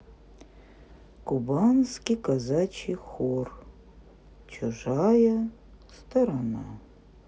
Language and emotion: Russian, neutral